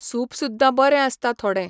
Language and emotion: Goan Konkani, neutral